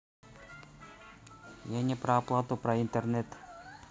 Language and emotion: Russian, neutral